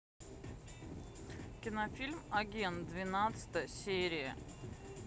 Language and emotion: Russian, neutral